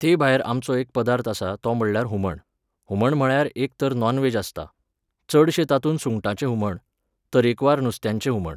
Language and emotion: Goan Konkani, neutral